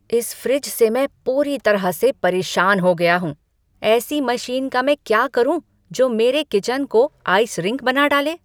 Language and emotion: Hindi, angry